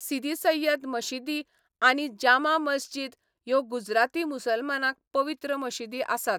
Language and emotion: Goan Konkani, neutral